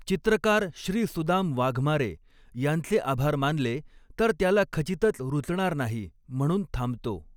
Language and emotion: Marathi, neutral